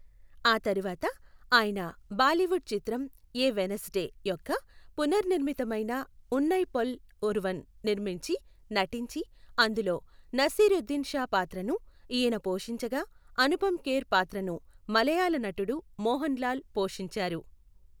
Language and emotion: Telugu, neutral